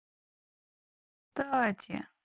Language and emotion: Russian, neutral